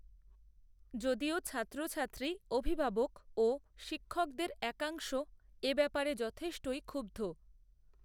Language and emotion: Bengali, neutral